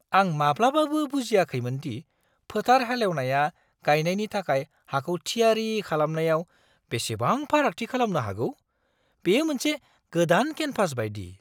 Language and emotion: Bodo, surprised